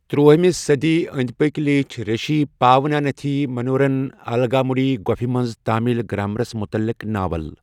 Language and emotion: Kashmiri, neutral